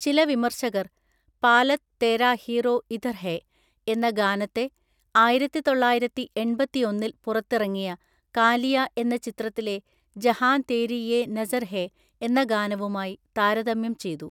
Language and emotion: Malayalam, neutral